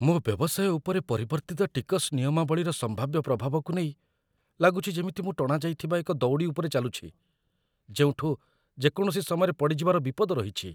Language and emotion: Odia, fearful